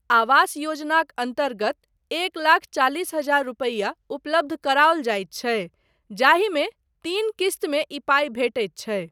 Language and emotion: Maithili, neutral